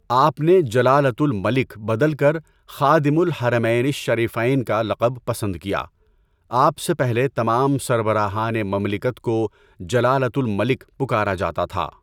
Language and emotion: Urdu, neutral